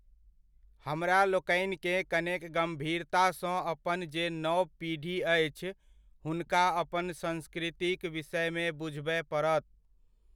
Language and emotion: Maithili, neutral